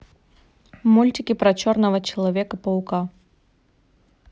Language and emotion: Russian, neutral